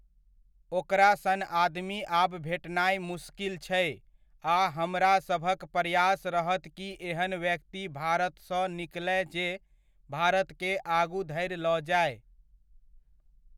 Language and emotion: Maithili, neutral